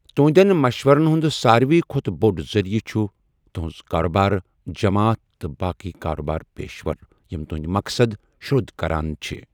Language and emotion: Kashmiri, neutral